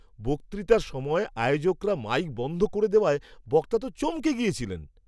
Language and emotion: Bengali, surprised